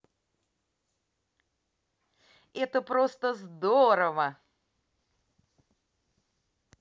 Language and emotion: Russian, positive